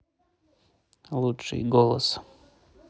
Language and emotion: Russian, neutral